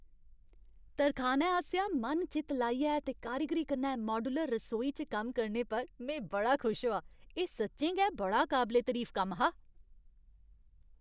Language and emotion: Dogri, happy